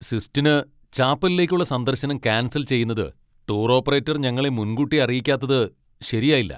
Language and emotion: Malayalam, angry